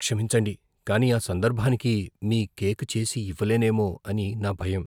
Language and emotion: Telugu, fearful